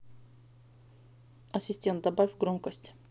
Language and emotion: Russian, neutral